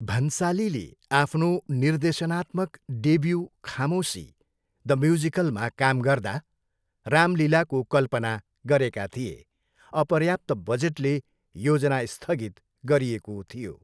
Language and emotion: Nepali, neutral